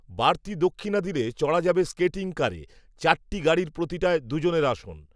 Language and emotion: Bengali, neutral